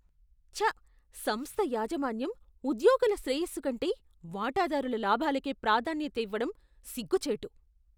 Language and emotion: Telugu, disgusted